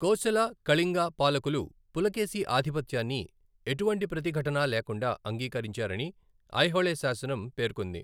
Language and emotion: Telugu, neutral